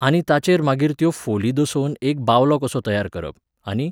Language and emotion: Goan Konkani, neutral